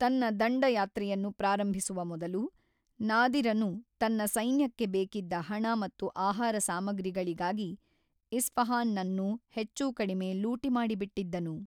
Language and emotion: Kannada, neutral